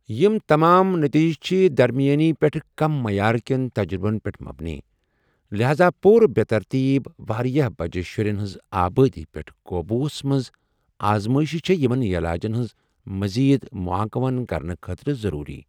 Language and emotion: Kashmiri, neutral